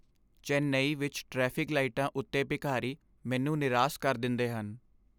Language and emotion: Punjabi, sad